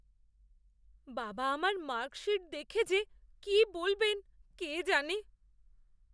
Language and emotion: Bengali, fearful